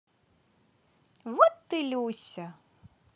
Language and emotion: Russian, positive